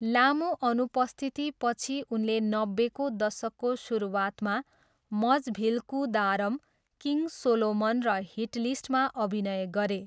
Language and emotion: Nepali, neutral